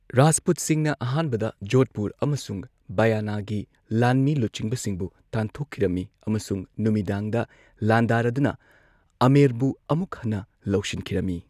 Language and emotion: Manipuri, neutral